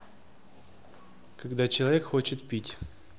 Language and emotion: Russian, neutral